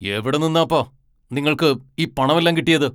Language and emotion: Malayalam, angry